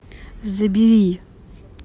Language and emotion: Russian, angry